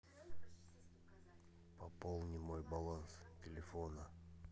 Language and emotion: Russian, neutral